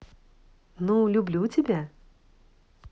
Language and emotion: Russian, positive